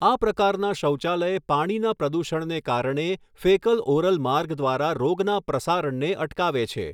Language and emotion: Gujarati, neutral